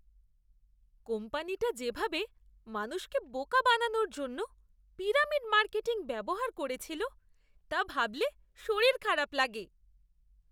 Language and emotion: Bengali, disgusted